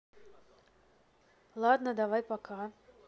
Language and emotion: Russian, neutral